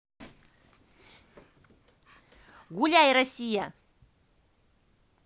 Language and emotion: Russian, positive